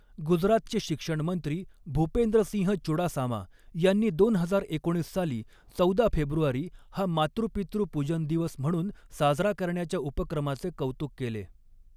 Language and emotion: Marathi, neutral